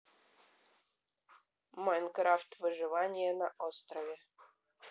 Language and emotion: Russian, neutral